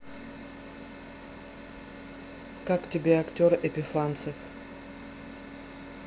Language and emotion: Russian, neutral